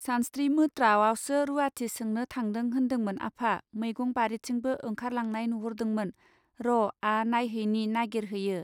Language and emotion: Bodo, neutral